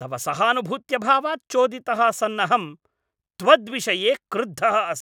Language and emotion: Sanskrit, angry